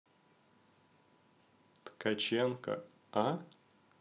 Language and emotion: Russian, neutral